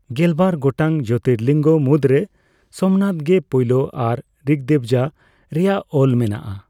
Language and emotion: Santali, neutral